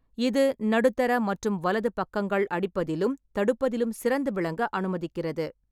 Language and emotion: Tamil, neutral